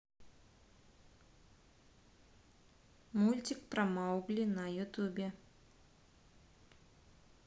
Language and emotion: Russian, neutral